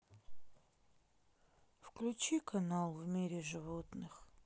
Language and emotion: Russian, sad